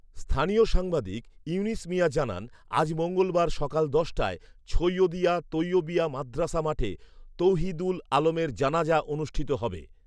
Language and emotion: Bengali, neutral